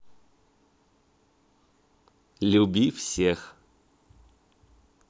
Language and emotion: Russian, positive